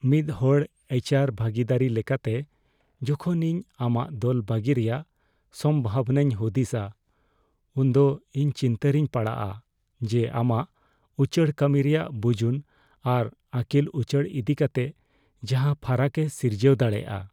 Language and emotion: Santali, fearful